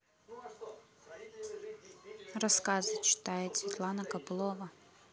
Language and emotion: Russian, neutral